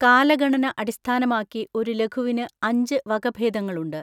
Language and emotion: Malayalam, neutral